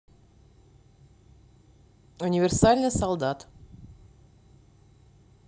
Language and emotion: Russian, neutral